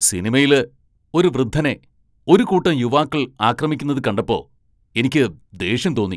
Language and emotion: Malayalam, angry